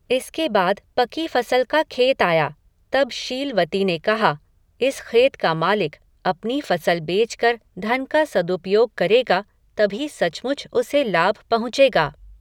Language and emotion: Hindi, neutral